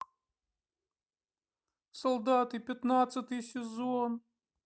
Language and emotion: Russian, sad